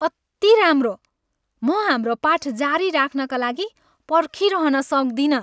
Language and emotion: Nepali, happy